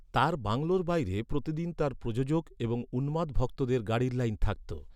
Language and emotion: Bengali, neutral